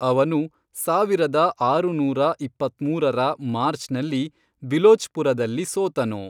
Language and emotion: Kannada, neutral